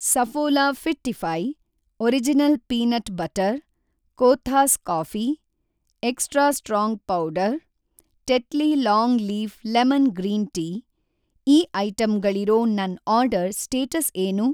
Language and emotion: Kannada, neutral